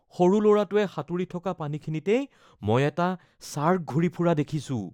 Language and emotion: Assamese, fearful